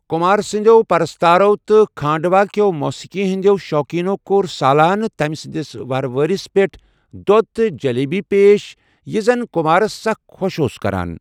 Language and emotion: Kashmiri, neutral